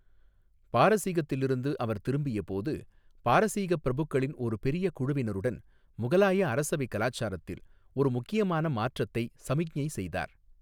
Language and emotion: Tamil, neutral